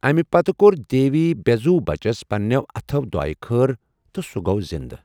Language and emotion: Kashmiri, neutral